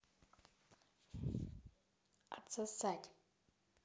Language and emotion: Russian, neutral